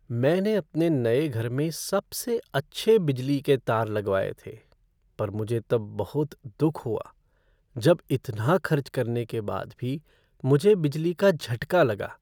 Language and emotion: Hindi, sad